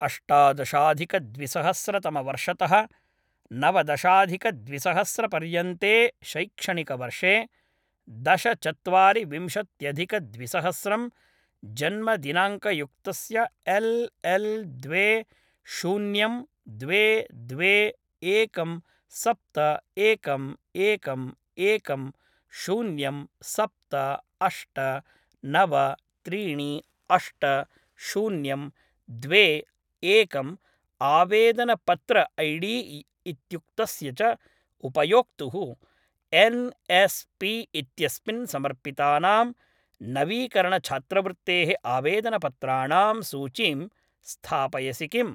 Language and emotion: Sanskrit, neutral